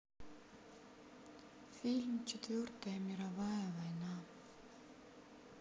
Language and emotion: Russian, sad